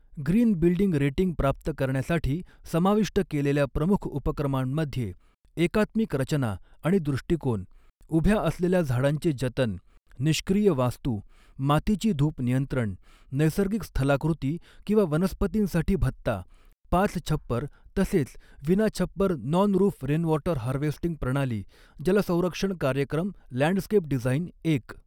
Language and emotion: Marathi, neutral